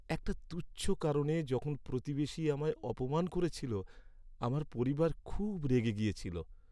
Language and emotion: Bengali, sad